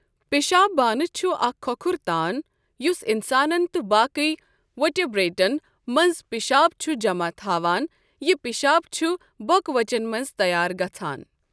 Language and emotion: Kashmiri, neutral